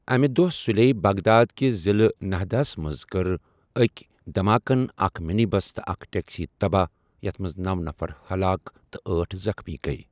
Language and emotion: Kashmiri, neutral